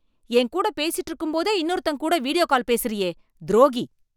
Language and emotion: Tamil, angry